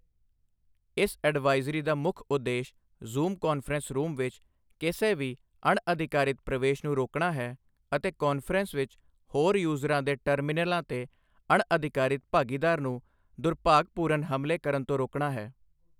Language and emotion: Punjabi, neutral